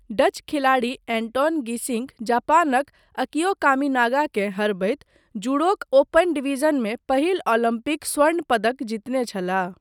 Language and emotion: Maithili, neutral